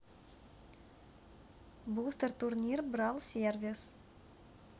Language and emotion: Russian, neutral